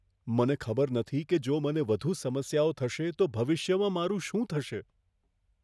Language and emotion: Gujarati, fearful